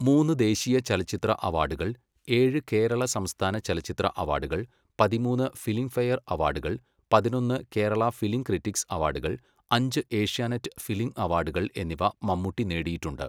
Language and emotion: Malayalam, neutral